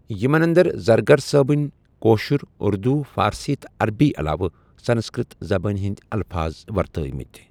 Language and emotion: Kashmiri, neutral